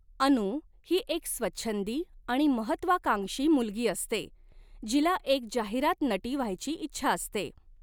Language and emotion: Marathi, neutral